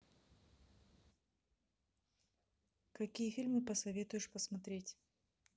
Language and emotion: Russian, neutral